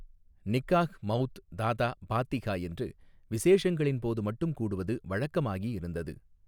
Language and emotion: Tamil, neutral